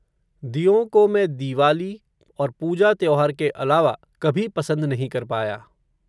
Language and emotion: Hindi, neutral